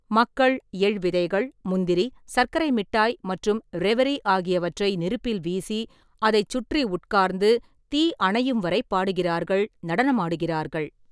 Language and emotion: Tamil, neutral